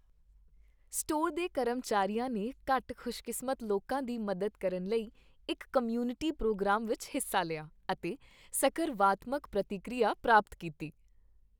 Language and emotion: Punjabi, happy